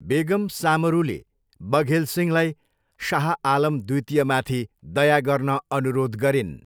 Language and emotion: Nepali, neutral